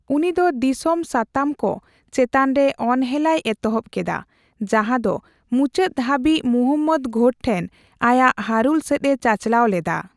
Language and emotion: Santali, neutral